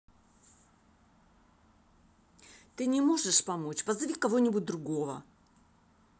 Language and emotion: Russian, angry